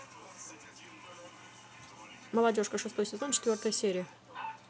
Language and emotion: Russian, neutral